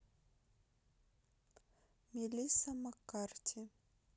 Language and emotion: Russian, neutral